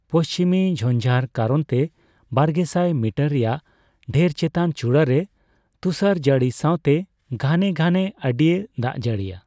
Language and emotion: Santali, neutral